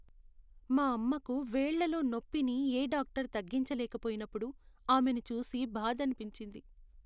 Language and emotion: Telugu, sad